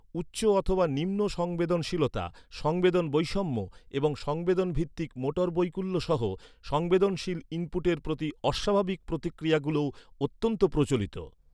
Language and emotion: Bengali, neutral